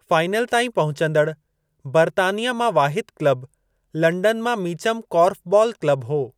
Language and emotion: Sindhi, neutral